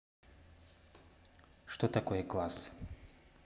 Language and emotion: Russian, neutral